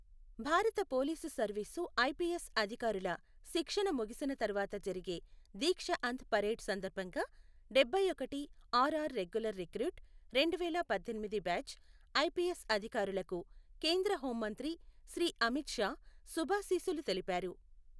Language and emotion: Telugu, neutral